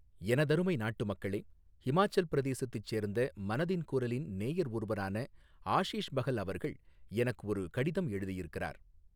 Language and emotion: Tamil, neutral